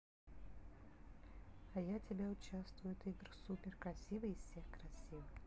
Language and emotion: Russian, neutral